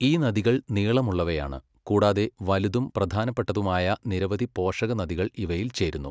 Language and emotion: Malayalam, neutral